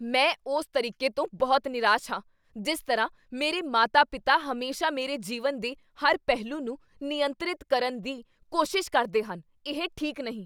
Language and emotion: Punjabi, angry